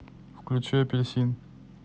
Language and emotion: Russian, neutral